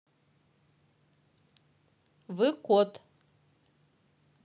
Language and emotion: Russian, neutral